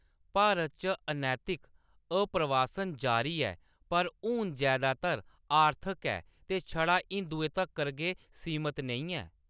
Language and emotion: Dogri, neutral